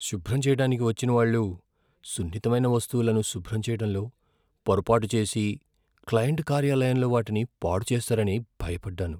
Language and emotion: Telugu, fearful